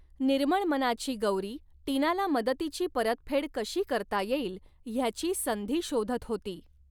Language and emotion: Marathi, neutral